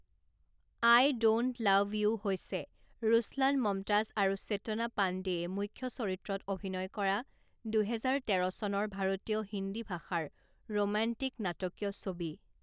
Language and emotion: Assamese, neutral